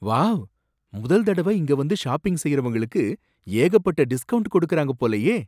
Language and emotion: Tamil, surprised